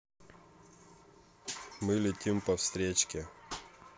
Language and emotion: Russian, neutral